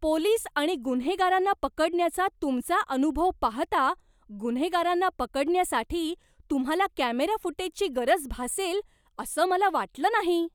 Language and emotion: Marathi, surprised